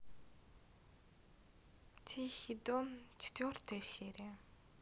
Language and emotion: Russian, sad